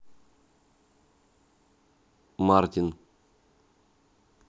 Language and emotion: Russian, neutral